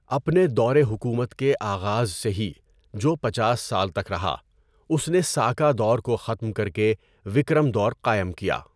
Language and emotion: Urdu, neutral